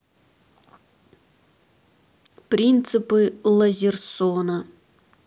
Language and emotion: Russian, neutral